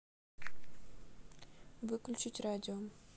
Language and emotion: Russian, neutral